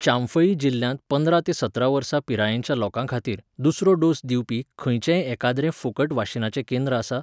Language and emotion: Goan Konkani, neutral